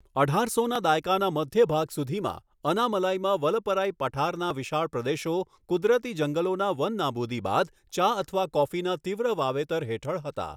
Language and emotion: Gujarati, neutral